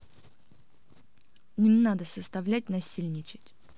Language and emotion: Russian, angry